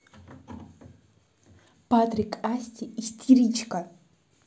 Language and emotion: Russian, neutral